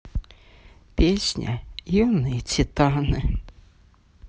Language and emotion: Russian, sad